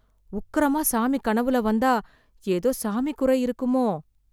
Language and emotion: Tamil, fearful